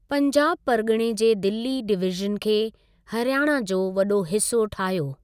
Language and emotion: Sindhi, neutral